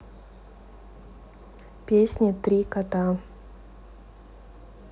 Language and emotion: Russian, neutral